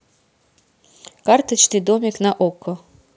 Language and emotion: Russian, neutral